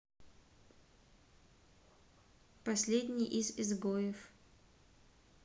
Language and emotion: Russian, neutral